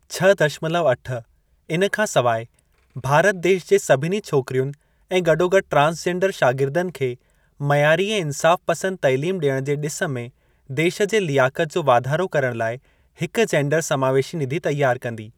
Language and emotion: Sindhi, neutral